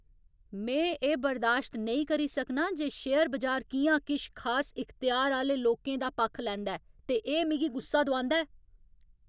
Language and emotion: Dogri, angry